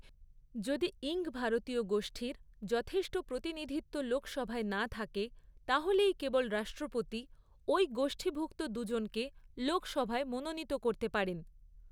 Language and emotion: Bengali, neutral